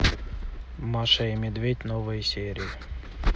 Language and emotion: Russian, neutral